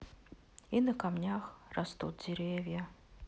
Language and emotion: Russian, sad